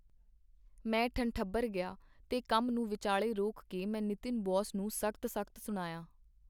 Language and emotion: Punjabi, neutral